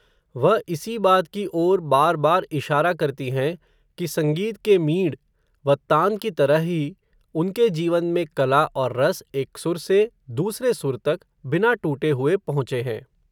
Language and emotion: Hindi, neutral